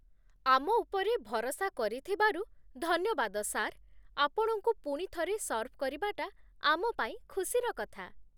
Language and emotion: Odia, happy